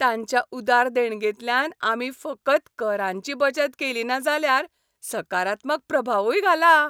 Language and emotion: Goan Konkani, happy